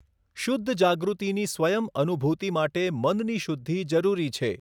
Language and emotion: Gujarati, neutral